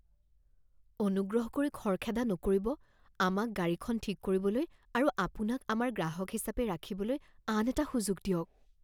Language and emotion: Assamese, fearful